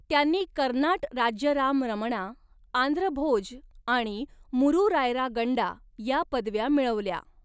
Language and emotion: Marathi, neutral